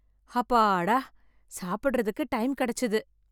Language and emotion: Tamil, happy